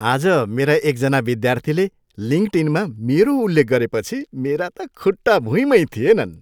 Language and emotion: Nepali, happy